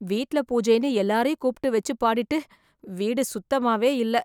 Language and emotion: Tamil, disgusted